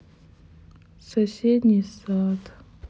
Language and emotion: Russian, sad